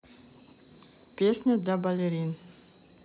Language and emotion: Russian, neutral